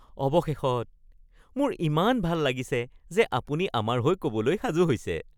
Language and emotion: Assamese, happy